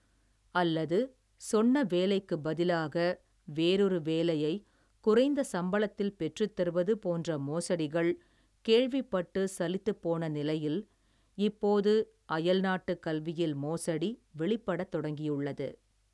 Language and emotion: Tamil, neutral